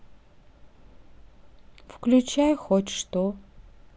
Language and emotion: Russian, sad